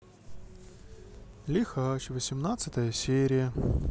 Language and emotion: Russian, sad